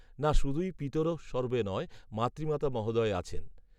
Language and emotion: Bengali, neutral